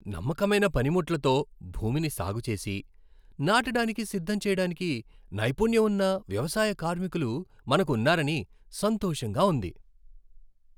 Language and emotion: Telugu, happy